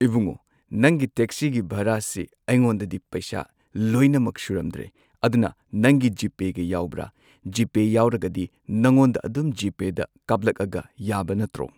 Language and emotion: Manipuri, neutral